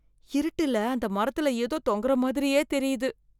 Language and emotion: Tamil, fearful